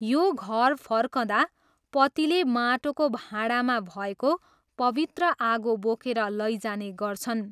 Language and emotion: Nepali, neutral